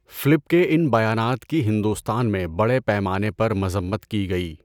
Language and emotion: Urdu, neutral